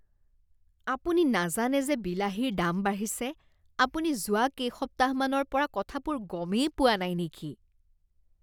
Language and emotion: Assamese, disgusted